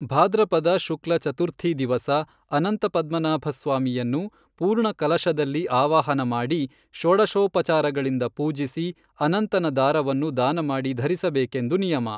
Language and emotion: Kannada, neutral